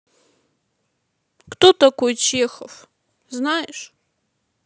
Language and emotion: Russian, sad